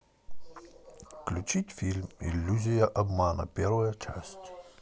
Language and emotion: Russian, neutral